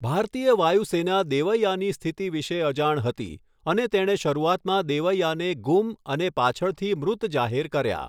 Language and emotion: Gujarati, neutral